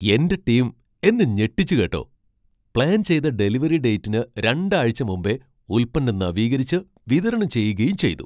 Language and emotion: Malayalam, surprised